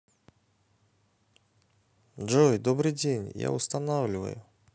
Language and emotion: Russian, positive